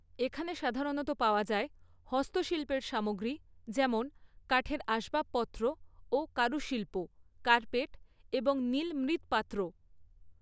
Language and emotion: Bengali, neutral